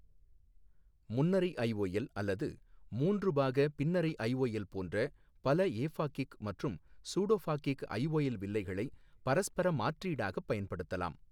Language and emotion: Tamil, neutral